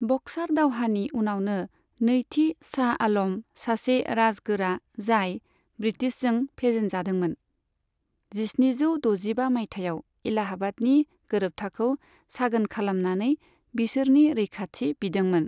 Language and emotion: Bodo, neutral